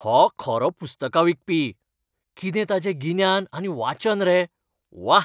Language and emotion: Goan Konkani, happy